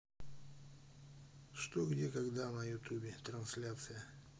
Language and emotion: Russian, neutral